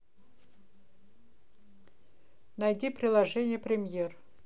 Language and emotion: Russian, neutral